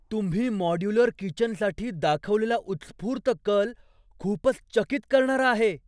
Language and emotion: Marathi, surprised